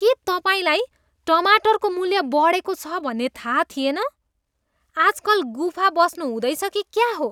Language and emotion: Nepali, disgusted